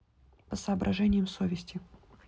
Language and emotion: Russian, neutral